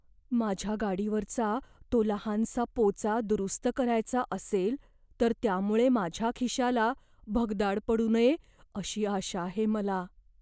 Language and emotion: Marathi, fearful